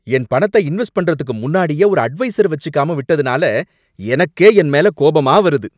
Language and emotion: Tamil, angry